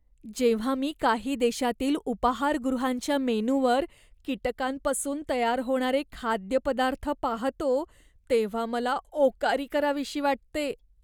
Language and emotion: Marathi, disgusted